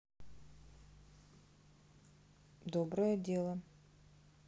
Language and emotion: Russian, neutral